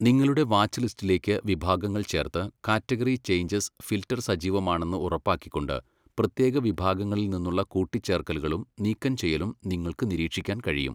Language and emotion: Malayalam, neutral